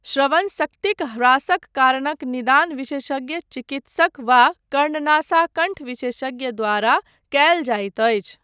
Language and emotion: Maithili, neutral